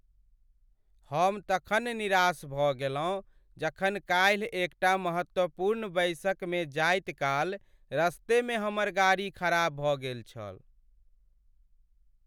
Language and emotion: Maithili, sad